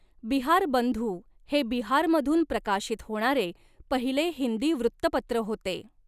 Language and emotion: Marathi, neutral